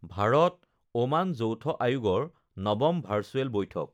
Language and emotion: Assamese, neutral